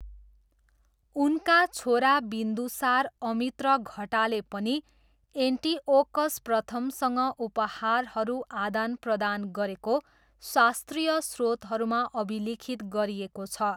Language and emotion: Nepali, neutral